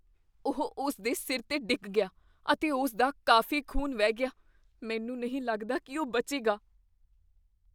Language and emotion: Punjabi, fearful